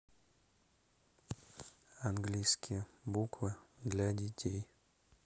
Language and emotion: Russian, neutral